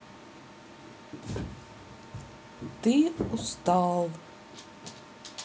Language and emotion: Russian, sad